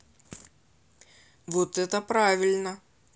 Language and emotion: Russian, positive